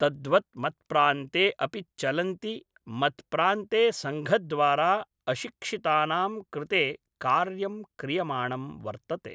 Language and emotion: Sanskrit, neutral